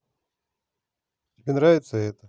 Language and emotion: Russian, positive